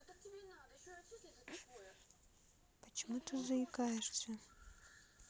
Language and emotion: Russian, sad